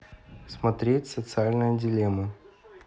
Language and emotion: Russian, neutral